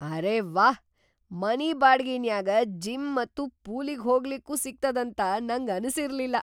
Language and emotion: Kannada, surprised